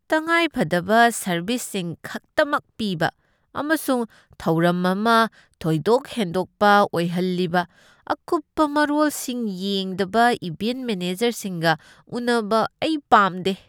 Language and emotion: Manipuri, disgusted